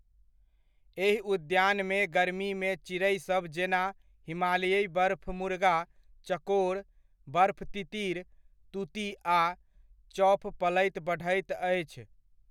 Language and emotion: Maithili, neutral